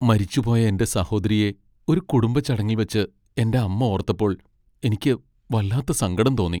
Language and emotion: Malayalam, sad